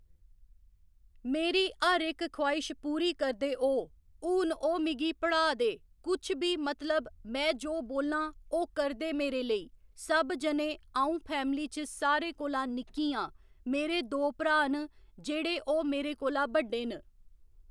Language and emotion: Dogri, neutral